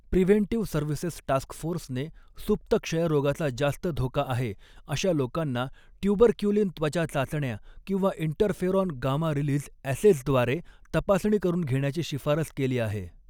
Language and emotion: Marathi, neutral